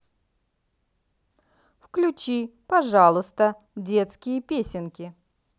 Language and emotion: Russian, positive